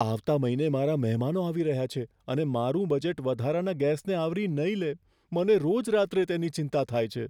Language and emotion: Gujarati, fearful